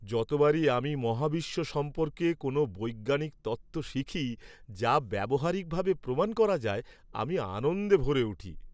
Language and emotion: Bengali, happy